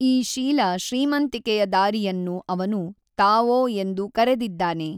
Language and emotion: Kannada, neutral